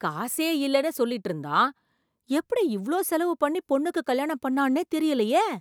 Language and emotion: Tamil, surprised